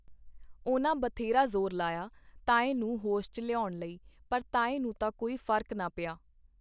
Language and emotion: Punjabi, neutral